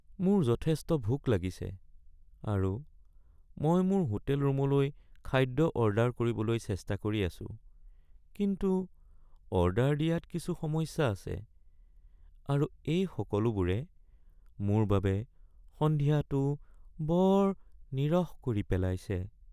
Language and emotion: Assamese, sad